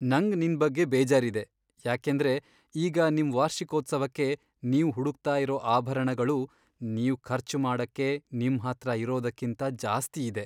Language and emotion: Kannada, sad